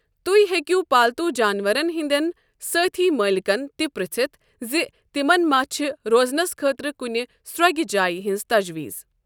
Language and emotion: Kashmiri, neutral